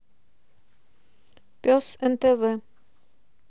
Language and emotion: Russian, neutral